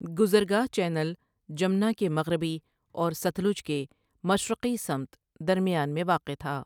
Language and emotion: Urdu, neutral